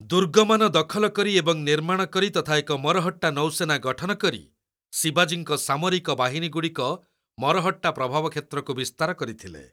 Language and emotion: Odia, neutral